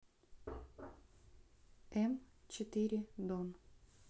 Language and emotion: Russian, neutral